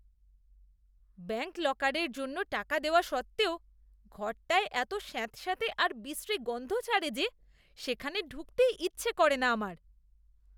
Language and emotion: Bengali, disgusted